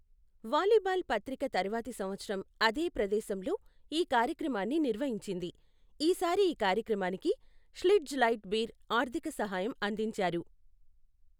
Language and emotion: Telugu, neutral